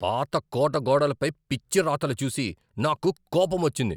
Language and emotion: Telugu, angry